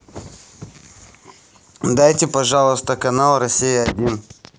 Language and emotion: Russian, neutral